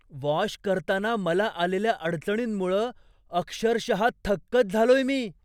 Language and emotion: Marathi, surprised